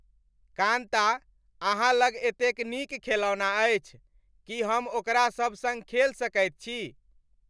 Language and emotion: Maithili, happy